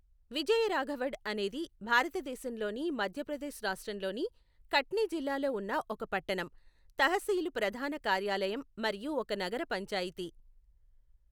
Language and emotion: Telugu, neutral